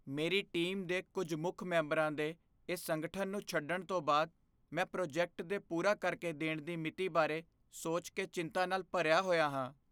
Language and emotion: Punjabi, fearful